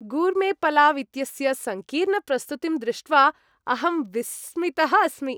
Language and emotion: Sanskrit, happy